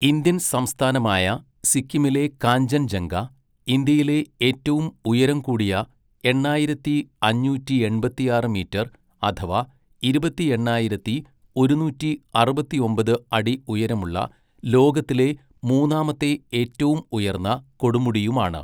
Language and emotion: Malayalam, neutral